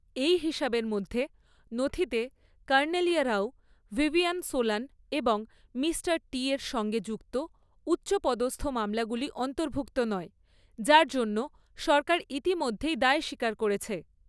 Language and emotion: Bengali, neutral